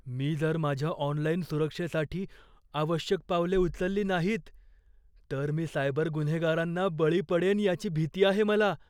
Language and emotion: Marathi, fearful